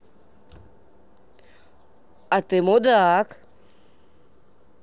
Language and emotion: Russian, neutral